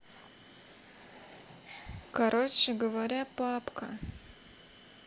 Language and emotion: Russian, neutral